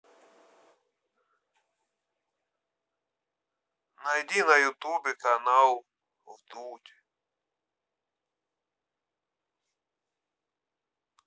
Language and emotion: Russian, neutral